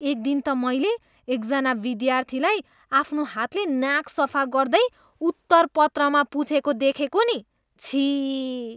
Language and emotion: Nepali, disgusted